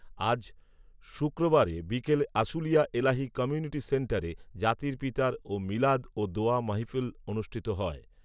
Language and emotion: Bengali, neutral